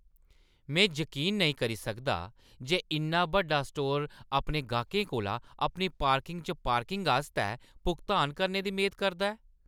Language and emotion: Dogri, angry